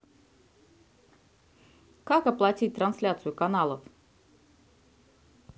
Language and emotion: Russian, neutral